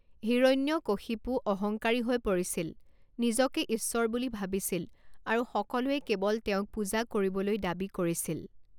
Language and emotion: Assamese, neutral